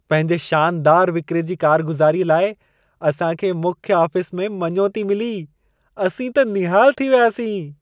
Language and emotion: Sindhi, happy